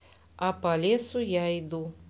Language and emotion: Russian, neutral